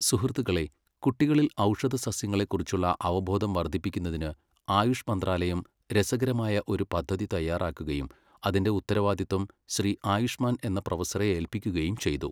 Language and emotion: Malayalam, neutral